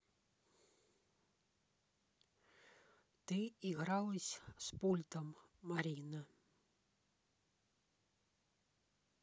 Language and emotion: Russian, neutral